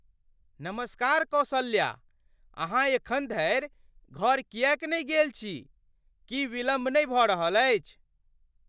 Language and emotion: Maithili, surprised